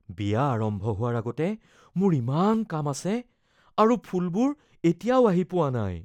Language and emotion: Assamese, fearful